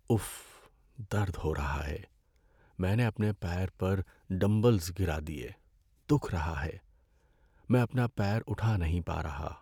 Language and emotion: Urdu, sad